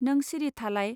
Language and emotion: Bodo, neutral